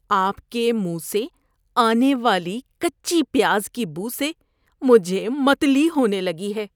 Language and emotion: Urdu, disgusted